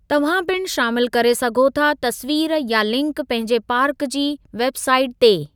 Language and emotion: Sindhi, neutral